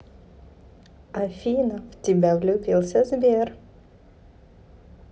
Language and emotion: Russian, positive